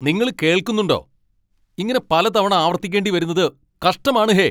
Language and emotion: Malayalam, angry